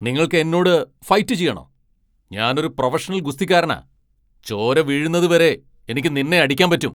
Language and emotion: Malayalam, angry